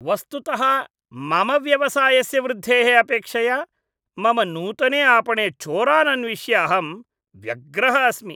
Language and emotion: Sanskrit, disgusted